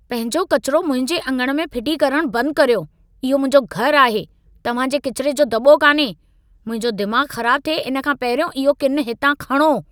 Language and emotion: Sindhi, angry